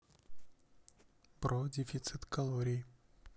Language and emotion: Russian, neutral